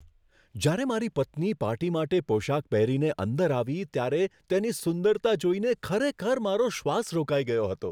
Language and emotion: Gujarati, surprised